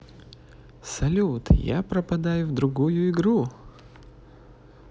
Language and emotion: Russian, positive